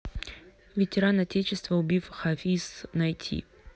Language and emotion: Russian, neutral